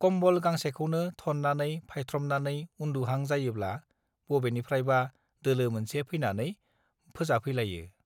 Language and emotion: Bodo, neutral